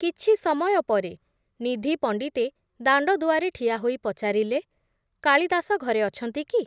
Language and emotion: Odia, neutral